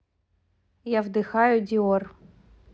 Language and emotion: Russian, neutral